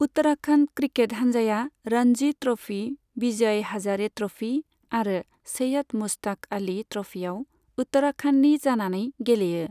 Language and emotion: Bodo, neutral